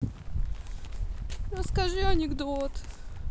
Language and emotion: Russian, sad